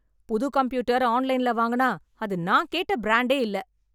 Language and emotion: Tamil, angry